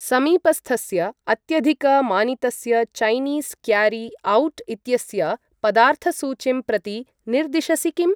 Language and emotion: Sanskrit, neutral